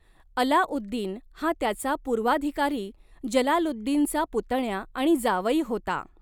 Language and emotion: Marathi, neutral